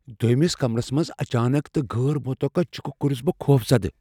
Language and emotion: Kashmiri, fearful